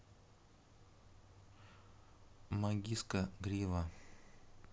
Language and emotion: Russian, neutral